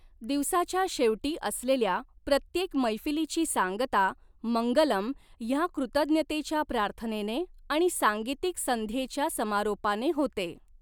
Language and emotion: Marathi, neutral